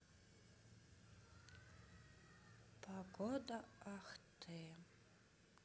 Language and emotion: Russian, sad